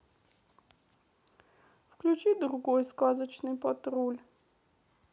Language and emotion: Russian, sad